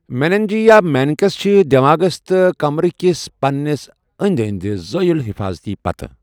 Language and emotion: Kashmiri, neutral